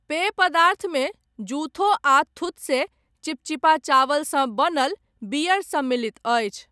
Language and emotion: Maithili, neutral